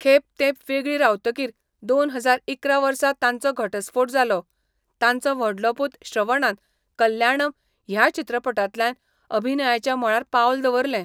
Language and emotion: Goan Konkani, neutral